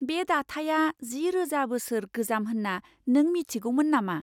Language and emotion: Bodo, surprised